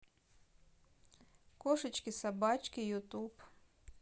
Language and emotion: Russian, neutral